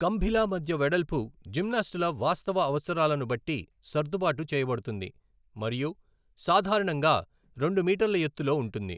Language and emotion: Telugu, neutral